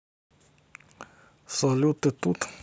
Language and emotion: Russian, neutral